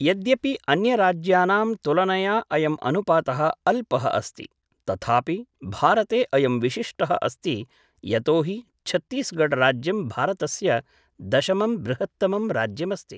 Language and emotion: Sanskrit, neutral